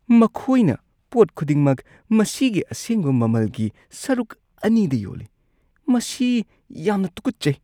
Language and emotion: Manipuri, disgusted